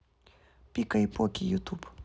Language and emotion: Russian, neutral